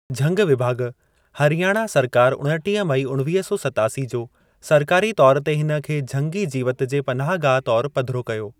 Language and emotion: Sindhi, neutral